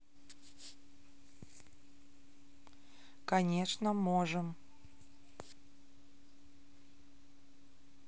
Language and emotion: Russian, neutral